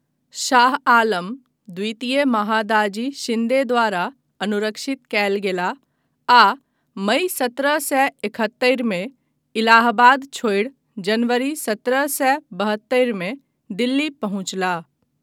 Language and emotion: Maithili, neutral